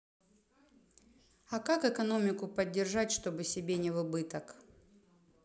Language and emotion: Russian, neutral